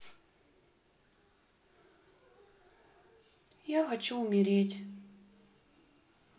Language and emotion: Russian, sad